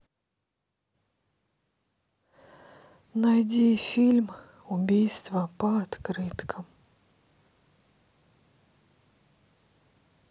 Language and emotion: Russian, sad